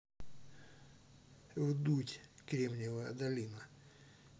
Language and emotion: Russian, neutral